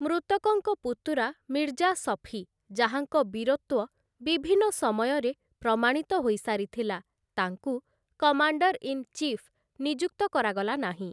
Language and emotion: Odia, neutral